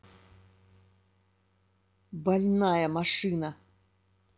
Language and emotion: Russian, angry